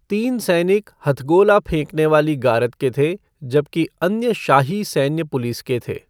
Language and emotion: Hindi, neutral